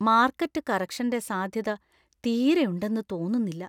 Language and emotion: Malayalam, fearful